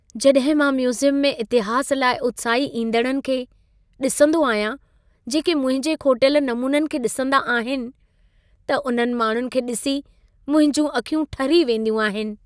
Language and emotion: Sindhi, happy